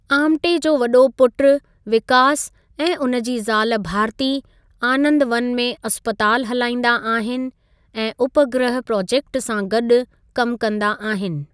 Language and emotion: Sindhi, neutral